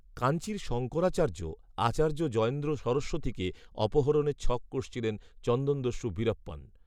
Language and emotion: Bengali, neutral